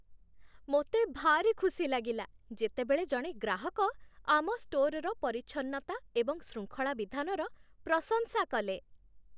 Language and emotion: Odia, happy